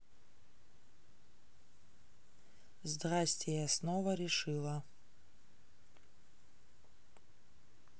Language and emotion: Russian, neutral